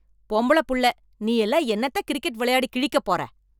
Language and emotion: Tamil, angry